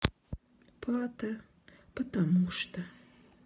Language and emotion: Russian, sad